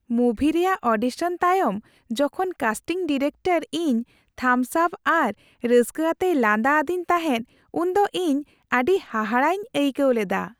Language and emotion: Santali, happy